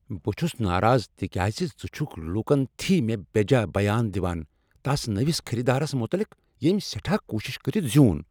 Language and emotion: Kashmiri, angry